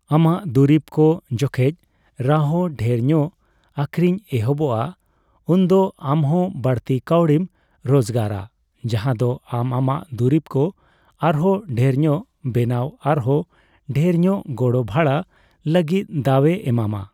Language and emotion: Santali, neutral